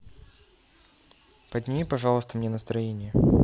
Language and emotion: Russian, neutral